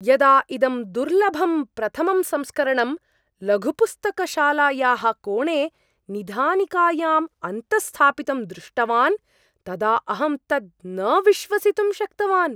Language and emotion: Sanskrit, surprised